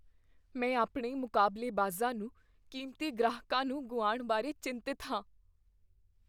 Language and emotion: Punjabi, fearful